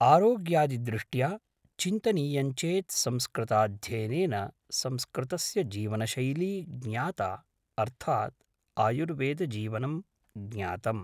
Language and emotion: Sanskrit, neutral